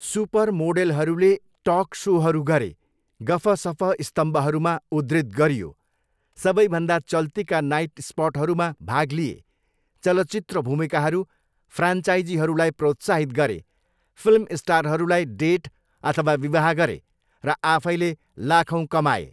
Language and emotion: Nepali, neutral